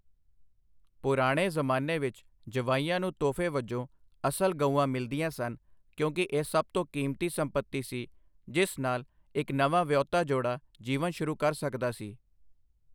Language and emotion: Punjabi, neutral